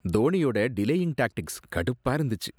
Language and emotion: Tamil, disgusted